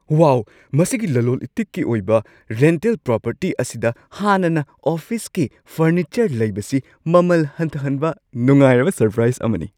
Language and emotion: Manipuri, surprised